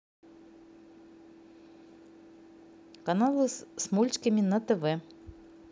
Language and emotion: Russian, neutral